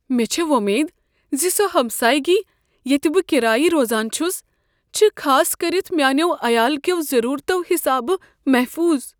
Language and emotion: Kashmiri, fearful